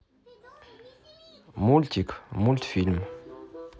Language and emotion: Russian, neutral